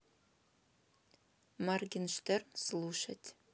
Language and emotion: Russian, neutral